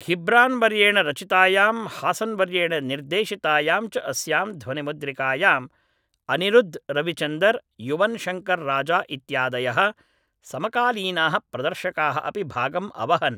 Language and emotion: Sanskrit, neutral